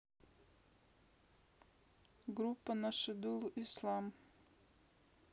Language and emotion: Russian, neutral